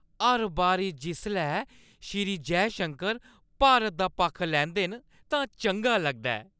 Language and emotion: Dogri, happy